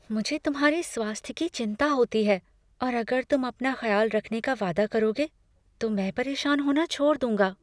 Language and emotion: Hindi, fearful